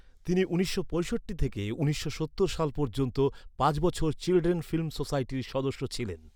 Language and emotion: Bengali, neutral